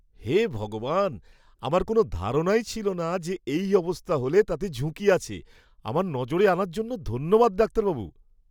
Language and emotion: Bengali, surprised